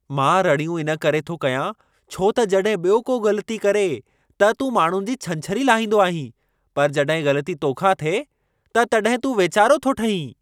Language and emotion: Sindhi, angry